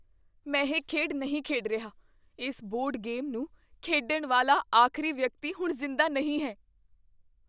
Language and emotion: Punjabi, fearful